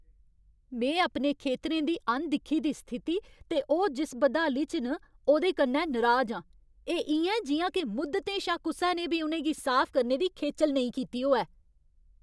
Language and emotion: Dogri, angry